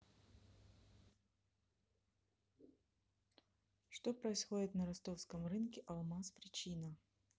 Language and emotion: Russian, neutral